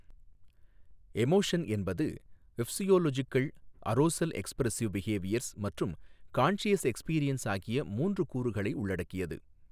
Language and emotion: Tamil, neutral